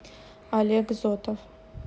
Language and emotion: Russian, neutral